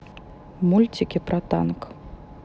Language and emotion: Russian, neutral